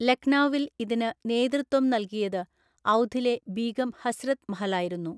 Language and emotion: Malayalam, neutral